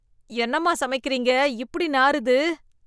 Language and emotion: Tamil, disgusted